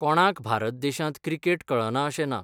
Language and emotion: Goan Konkani, neutral